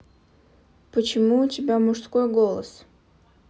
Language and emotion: Russian, neutral